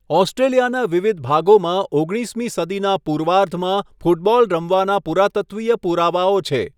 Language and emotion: Gujarati, neutral